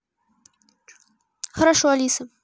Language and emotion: Russian, neutral